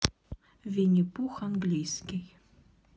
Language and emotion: Russian, neutral